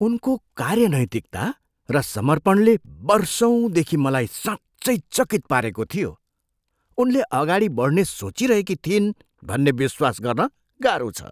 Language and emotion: Nepali, surprised